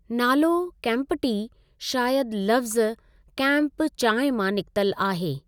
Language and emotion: Sindhi, neutral